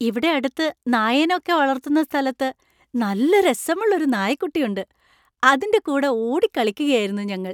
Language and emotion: Malayalam, happy